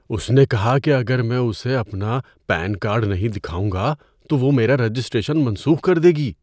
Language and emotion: Urdu, fearful